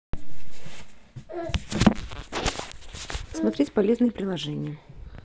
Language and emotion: Russian, neutral